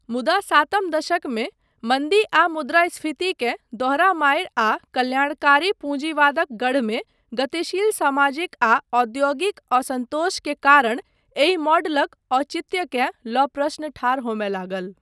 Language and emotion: Maithili, neutral